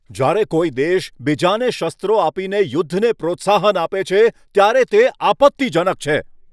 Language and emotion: Gujarati, angry